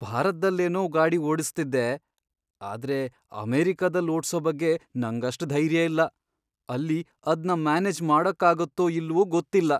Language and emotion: Kannada, fearful